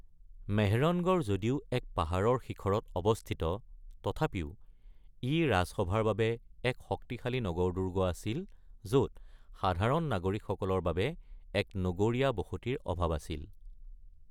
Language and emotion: Assamese, neutral